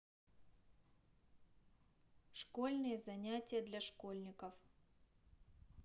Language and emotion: Russian, neutral